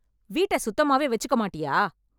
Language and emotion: Tamil, angry